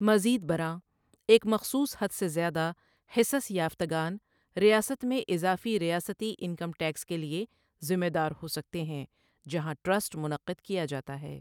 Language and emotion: Urdu, neutral